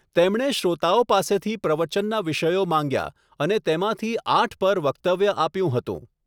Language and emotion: Gujarati, neutral